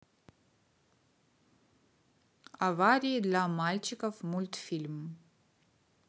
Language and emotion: Russian, neutral